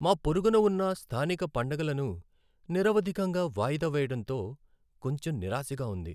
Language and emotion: Telugu, sad